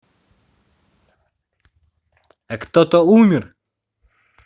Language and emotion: Russian, angry